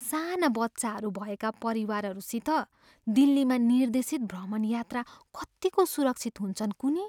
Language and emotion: Nepali, fearful